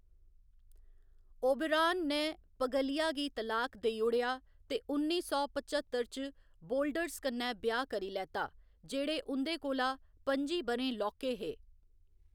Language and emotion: Dogri, neutral